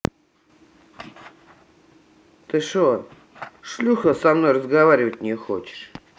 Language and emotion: Russian, angry